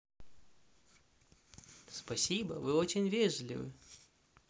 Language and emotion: Russian, positive